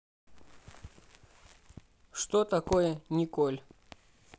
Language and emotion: Russian, neutral